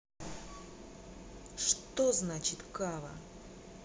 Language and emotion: Russian, angry